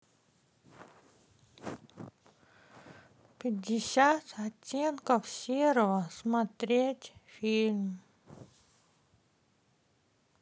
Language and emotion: Russian, sad